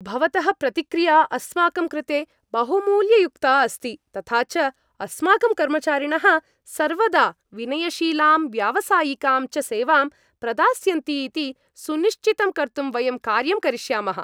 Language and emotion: Sanskrit, happy